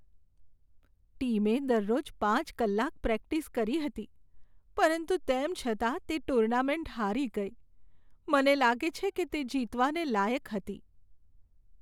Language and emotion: Gujarati, sad